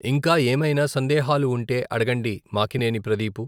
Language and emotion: Telugu, neutral